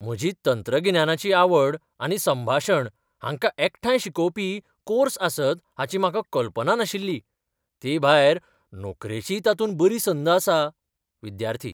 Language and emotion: Goan Konkani, surprised